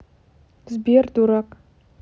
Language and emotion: Russian, neutral